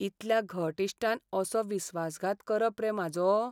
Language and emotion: Goan Konkani, sad